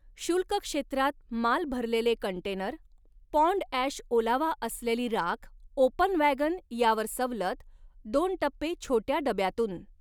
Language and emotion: Marathi, neutral